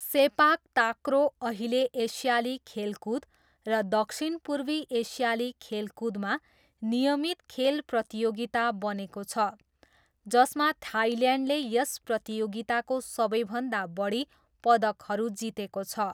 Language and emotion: Nepali, neutral